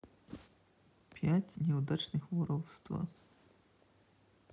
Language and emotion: Russian, neutral